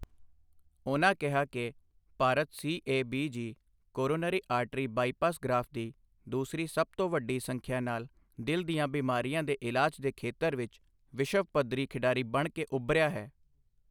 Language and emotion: Punjabi, neutral